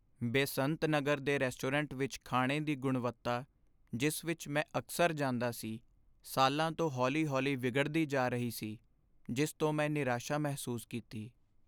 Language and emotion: Punjabi, sad